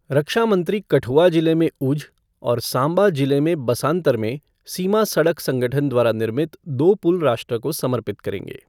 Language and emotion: Hindi, neutral